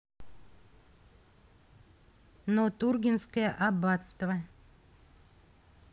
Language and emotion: Russian, neutral